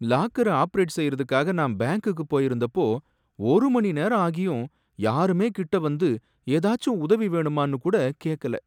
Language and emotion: Tamil, sad